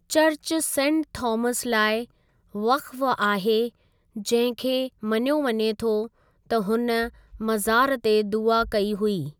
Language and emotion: Sindhi, neutral